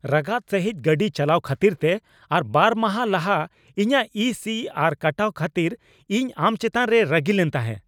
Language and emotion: Santali, angry